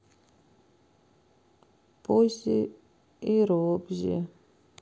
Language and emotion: Russian, sad